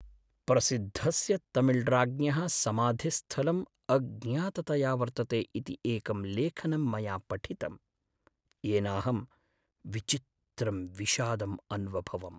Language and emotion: Sanskrit, sad